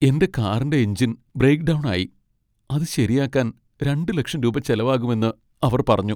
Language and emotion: Malayalam, sad